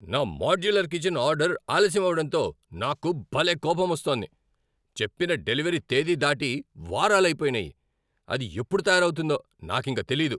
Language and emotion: Telugu, angry